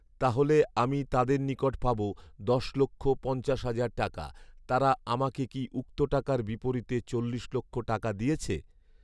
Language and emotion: Bengali, neutral